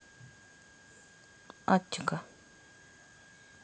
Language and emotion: Russian, neutral